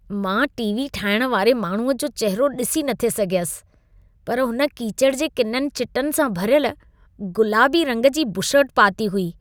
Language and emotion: Sindhi, disgusted